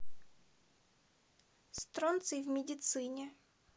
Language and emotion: Russian, neutral